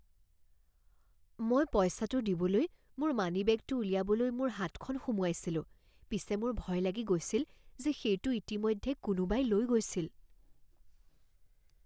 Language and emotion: Assamese, fearful